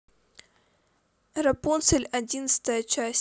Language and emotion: Russian, neutral